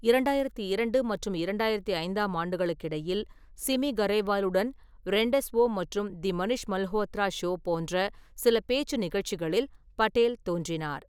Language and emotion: Tamil, neutral